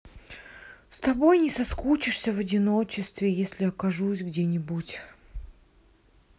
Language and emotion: Russian, sad